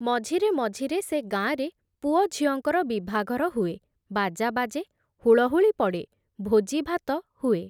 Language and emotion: Odia, neutral